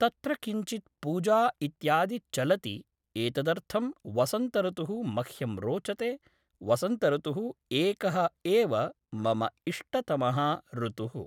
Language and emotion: Sanskrit, neutral